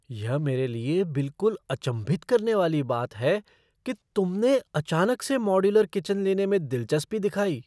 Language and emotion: Hindi, surprised